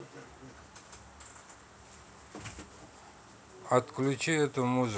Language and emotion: Russian, neutral